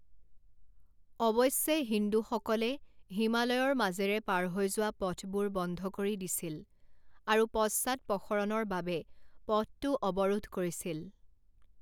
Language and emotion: Assamese, neutral